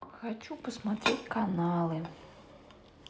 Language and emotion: Russian, sad